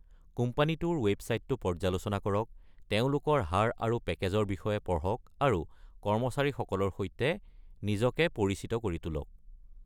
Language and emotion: Assamese, neutral